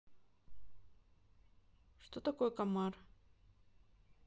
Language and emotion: Russian, neutral